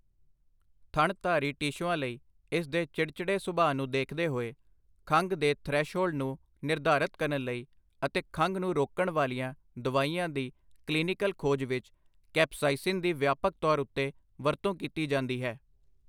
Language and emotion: Punjabi, neutral